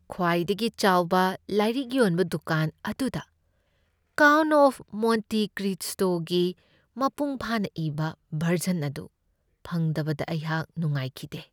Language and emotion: Manipuri, sad